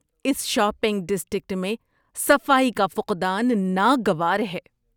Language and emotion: Urdu, disgusted